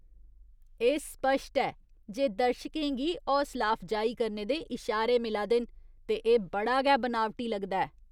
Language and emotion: Dogri, disgusted